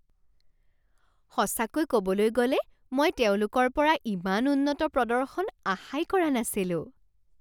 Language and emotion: Assamese, surprised